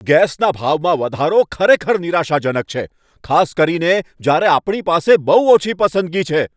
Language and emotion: Gujarati, angry